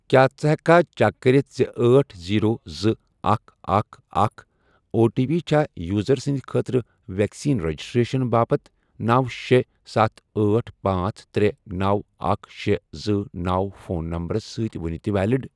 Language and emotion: Kashmiri, neutral